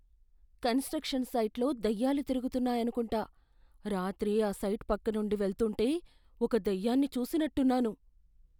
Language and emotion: Telugu, fearful